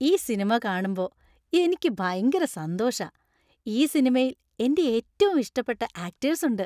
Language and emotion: Malayalam, happy